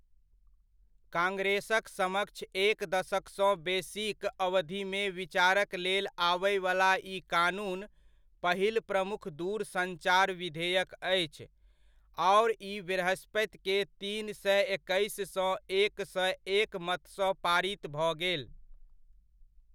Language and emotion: Maithili, neutral